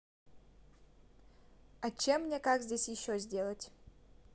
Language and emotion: Russian, neutral